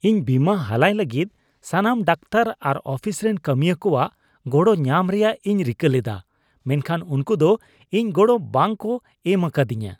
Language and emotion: Santali, disgusted